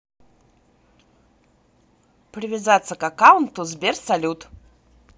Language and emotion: Russian, positive